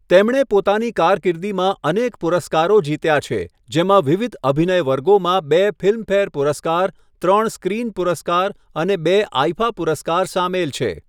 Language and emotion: Gujarati, neutral